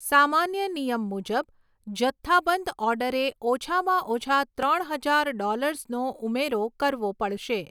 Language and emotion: Gujarati, neutral